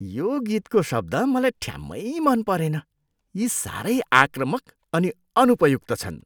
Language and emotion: Nepali, disgusted